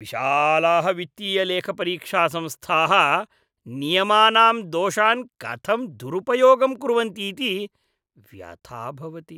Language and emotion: Sanskrit, disgusted